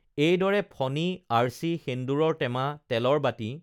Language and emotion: Assamese, neutral